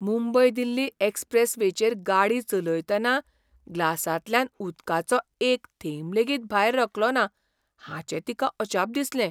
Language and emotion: Goan Konkani, surprised